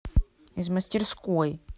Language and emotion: Russian, angry